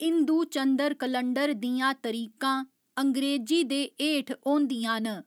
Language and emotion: Dogri, neutral